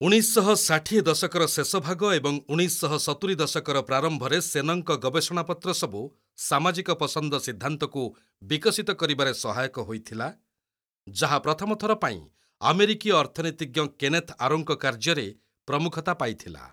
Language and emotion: Odia, neutral